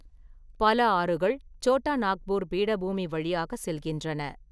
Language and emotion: Tamil, neutral